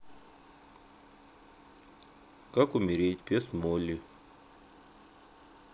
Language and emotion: Russian, sad